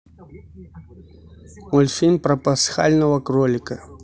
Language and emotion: Russian, neutral